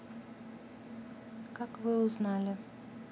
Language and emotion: Russian, neutral